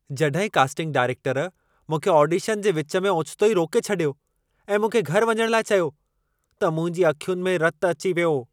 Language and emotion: Sindhi, angry